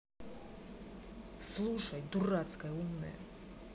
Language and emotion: Russian, angry